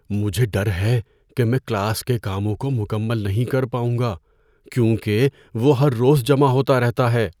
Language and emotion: Urdu, fearful